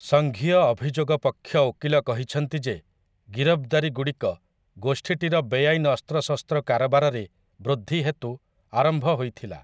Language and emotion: Odia, neutral